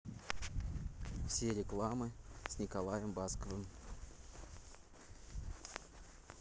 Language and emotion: Russian, neutral